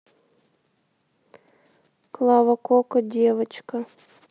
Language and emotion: Russian, neutral